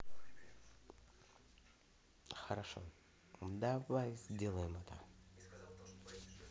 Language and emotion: Russian, positive